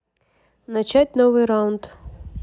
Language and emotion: Russian, neutral